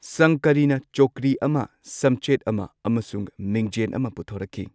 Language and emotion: Manipuri, neutral